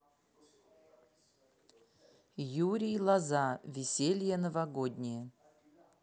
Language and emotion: Russian, neutral